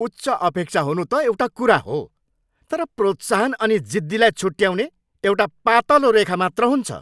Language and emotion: Nepali, angry